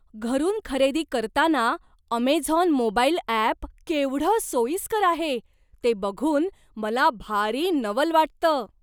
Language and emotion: Marathi, surprised